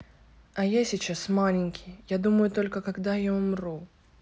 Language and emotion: Russian, sad